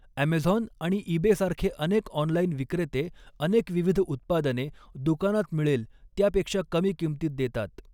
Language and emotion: Marathi, neutral